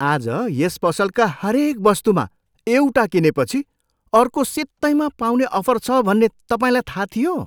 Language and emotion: Nepali, surprised